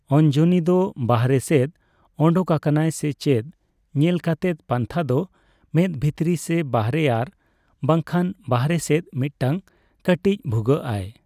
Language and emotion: Santali, neutral